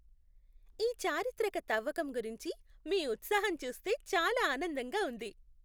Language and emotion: Telugu, happy